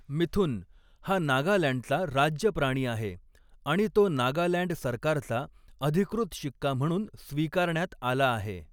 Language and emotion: Marathi, neutral